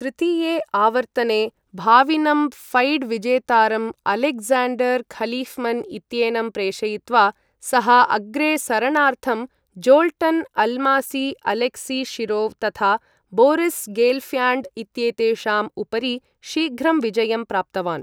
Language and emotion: Sanskrit, neutral